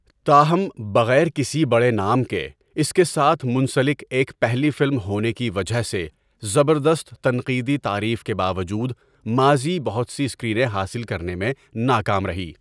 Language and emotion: Urdu, neutral